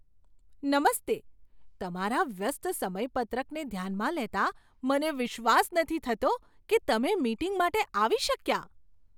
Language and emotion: Gujarati, surprised